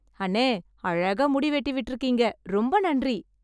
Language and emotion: Tamil, happy